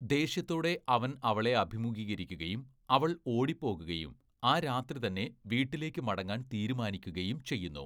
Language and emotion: Malayalam, neutral